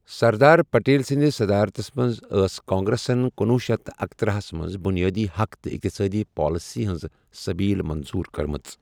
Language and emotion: Kashmiri, neutral